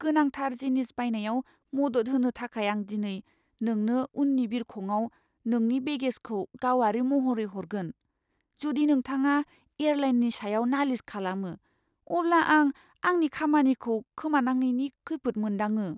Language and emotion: Bodo, fearful